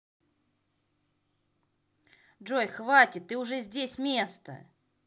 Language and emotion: Russian, angry